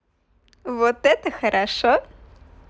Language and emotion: Russian, positive